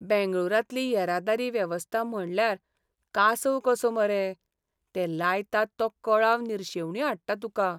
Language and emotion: Goan Konkani, sad